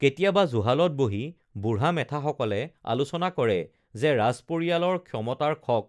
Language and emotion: Assamese, neutral